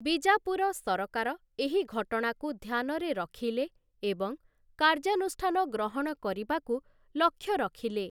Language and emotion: Odia, neutral